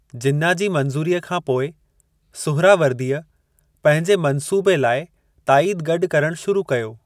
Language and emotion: Sindhi, neutral